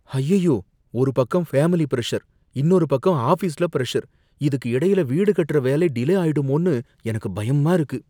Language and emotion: Tamil, fearful